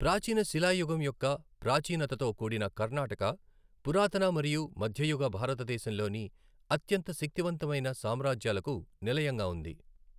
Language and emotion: Telugu, neutral